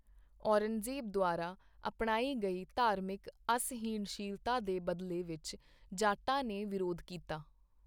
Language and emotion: Punjabi, neutral